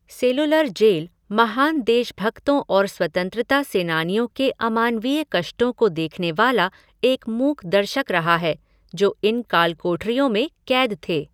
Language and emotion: Hindi, neutral